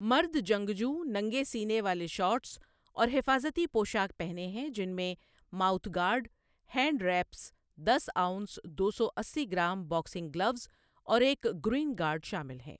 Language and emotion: Urdu, neutral